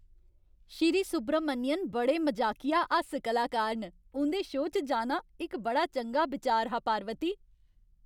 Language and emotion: Dogri, happy